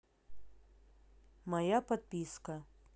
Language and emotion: Russian, neutral